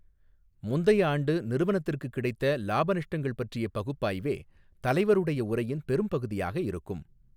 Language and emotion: Tamil, neutral